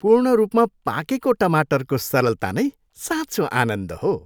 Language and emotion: Nepali, happy